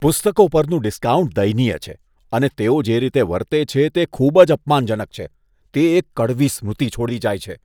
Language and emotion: Gujarati, disgusted